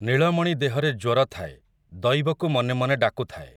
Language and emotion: Odia, neutral